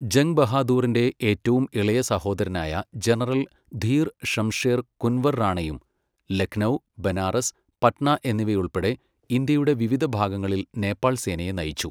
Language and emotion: Malayalam, neutral